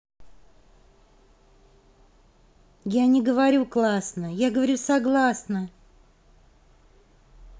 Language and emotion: Russian, neutral